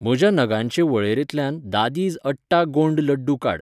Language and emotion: Goan Konkani, neutral